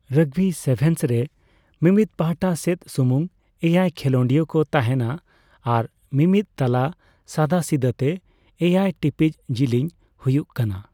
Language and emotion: Santali, neutral